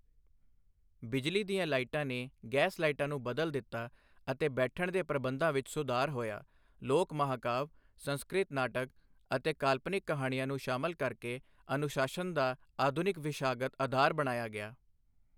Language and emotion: Punjabi, neutral